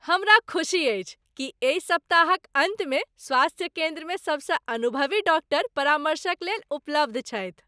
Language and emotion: Maithili, happy